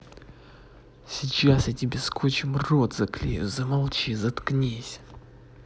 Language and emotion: Russian, angry